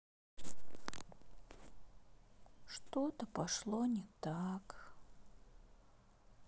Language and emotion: Russian, sad